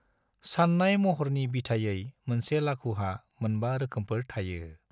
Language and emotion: Bodo, neutral